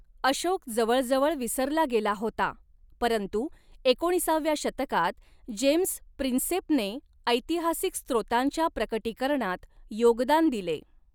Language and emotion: Marathi, neutral